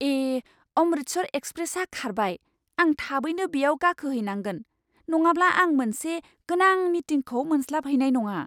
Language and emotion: Bodo, surprised